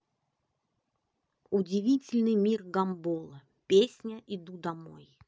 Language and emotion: Russian, neutral